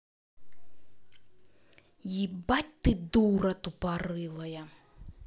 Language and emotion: Russian, angry